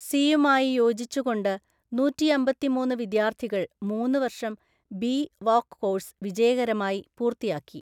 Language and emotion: Malayalam, neutral